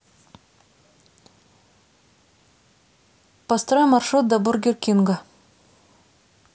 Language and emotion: Russian, neutral